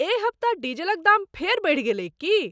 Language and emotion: Maithili, surprised